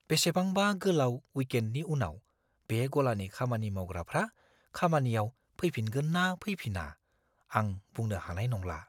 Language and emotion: Bodo, fearful